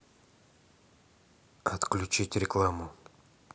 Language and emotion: Russian, neutral